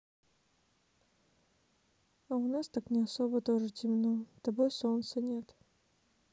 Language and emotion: Russian, sad